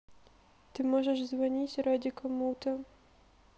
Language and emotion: Russian, sad